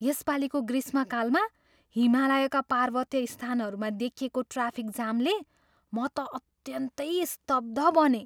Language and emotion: Nepali, surprised